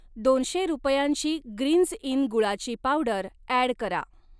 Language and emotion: Marathi, neutral